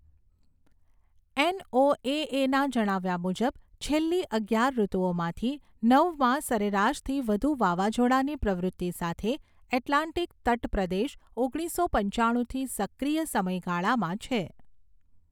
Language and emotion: Gujarati, neutral